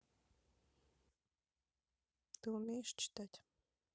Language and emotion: Russian, neutral